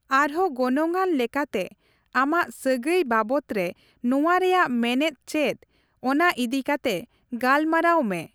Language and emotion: Santali, neutral